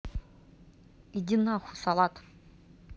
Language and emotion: Russian, angry